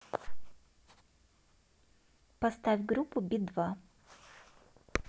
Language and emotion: Russian, neutral